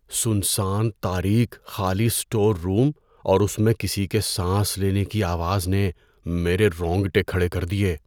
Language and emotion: Urdu, fearful